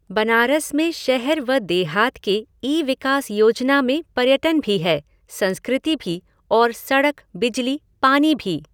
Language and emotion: Hindi, neutral